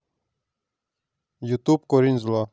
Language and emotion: Russian, neutral